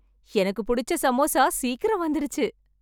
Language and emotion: Tamil, happy